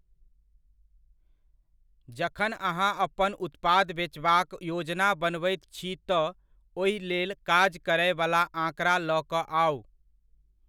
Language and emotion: Maithili, neutral